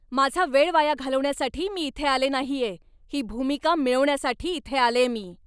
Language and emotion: Marathi, angry